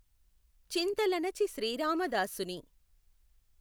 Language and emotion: Telugu, neutral